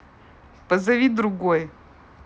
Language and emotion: Russian, neutral